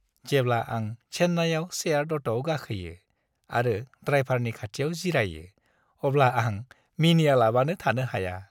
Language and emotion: Bodo, happy